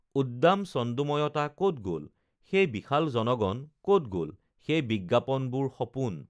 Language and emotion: Assamese, neutral